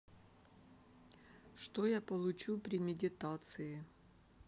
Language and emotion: Russian, neutral